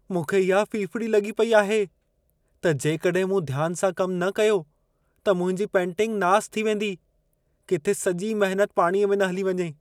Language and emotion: Sindhi, fearful